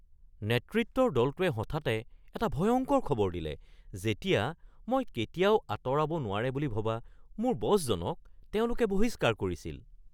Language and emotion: Assamese, surprised